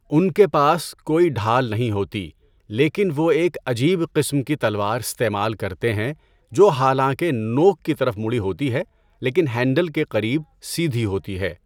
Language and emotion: Urdu, neutral